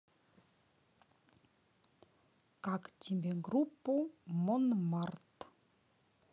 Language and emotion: Russian, neutral